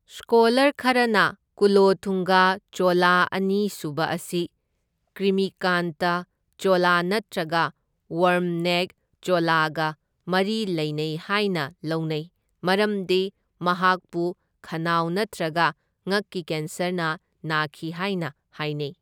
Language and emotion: Manipuri, neutral